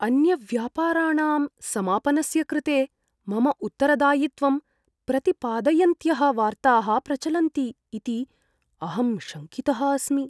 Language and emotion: Sanskrit, fearful